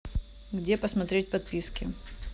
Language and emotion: Russian, neutral